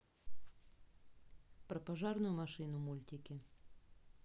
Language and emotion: Russian, neutral